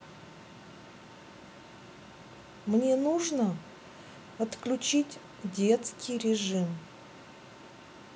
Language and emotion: Russian, neutral